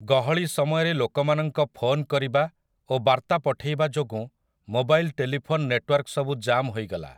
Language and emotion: Odia, neutral